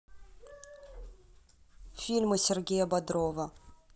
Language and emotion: Russian, neutral